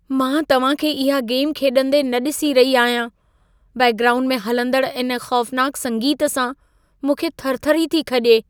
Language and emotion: Sindhi, fearful